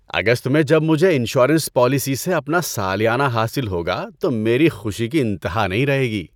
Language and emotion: Urdu, happy